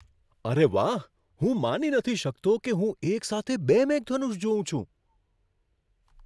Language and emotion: Gujarati, surprised